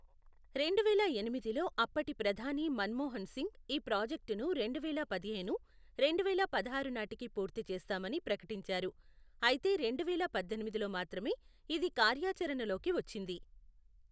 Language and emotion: Telugu, neutral